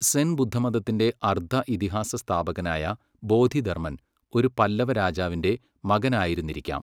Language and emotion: Malayalam, neutral